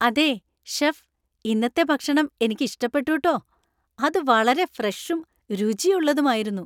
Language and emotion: Malayalam, happy